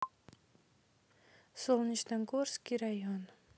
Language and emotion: Russian, neutral